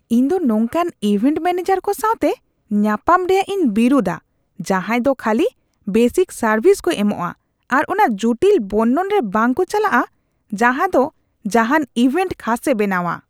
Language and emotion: Santali, disgusted